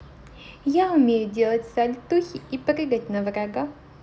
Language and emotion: Russian, positive